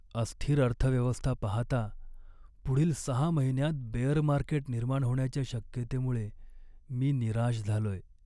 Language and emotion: Marathi, sad